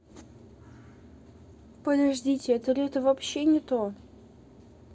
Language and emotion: Russian, neutral